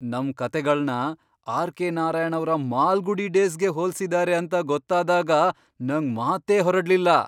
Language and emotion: Kannada, surprised